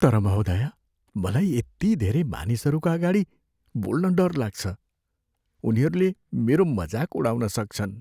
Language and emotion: Nepali, fearful